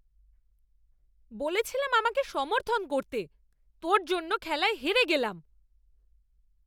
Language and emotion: Bengali, angry